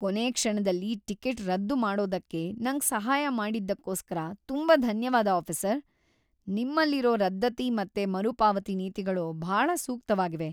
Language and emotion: Kannada, happy